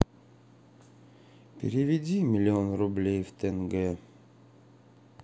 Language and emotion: Russian, sad